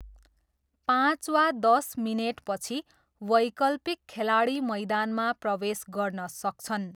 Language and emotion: Nepali, neutral